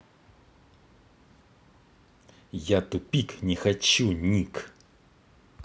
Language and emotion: Russian, angry